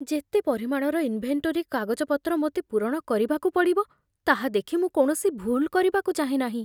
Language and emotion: Odia, fearful